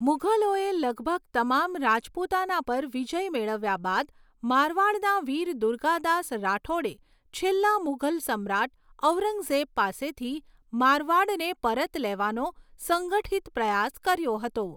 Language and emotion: Gujarati, neutral